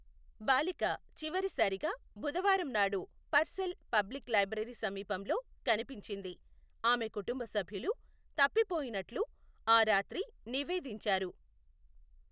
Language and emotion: Telugu, neutral